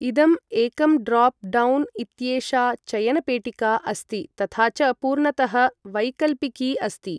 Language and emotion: Sanskrit, neutral